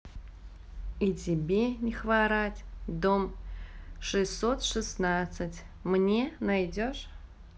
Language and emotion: Russian, neutral